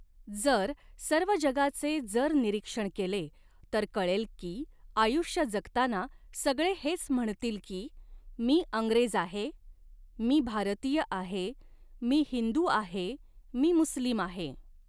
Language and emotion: Marathi, neutral